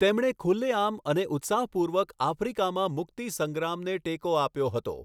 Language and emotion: Gujarati, neutral